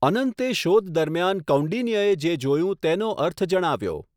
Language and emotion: Gujarati, neutral